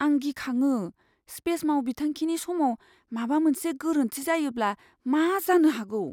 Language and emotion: Bodo, fearful